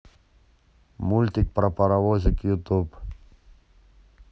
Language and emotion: Russian, neutral